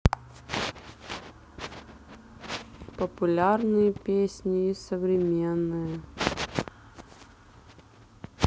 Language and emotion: Russian, neutral